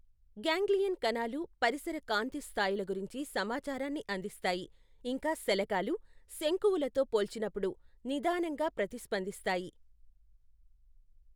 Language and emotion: Telugu, neutral